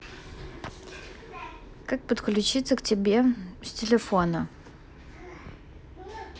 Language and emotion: Russian, neutral